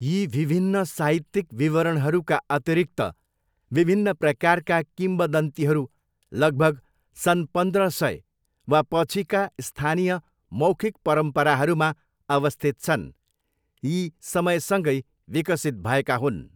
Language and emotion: Nepali, neutral